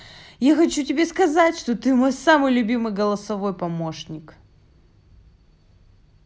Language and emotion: Russian, positive